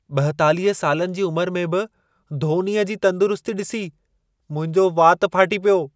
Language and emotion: Sindhi, surprised